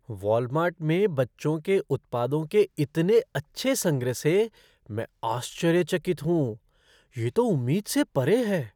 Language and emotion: Hindi, surprised